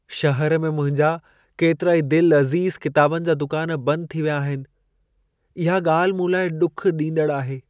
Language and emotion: Sindhi, sad